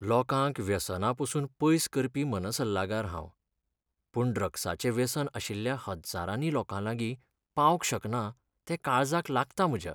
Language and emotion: Goan Konkani, sad